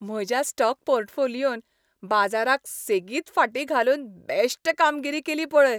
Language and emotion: Goan Konkani, happy